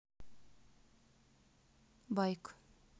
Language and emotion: Russian, neutral